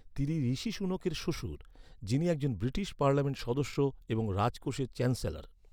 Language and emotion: Bengali, neutral